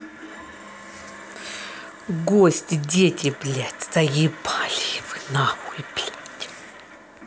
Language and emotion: Russian, angry